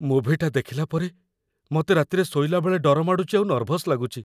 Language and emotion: Odia, fearful